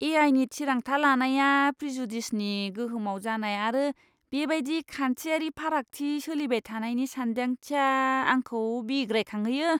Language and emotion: Bodo, disgusted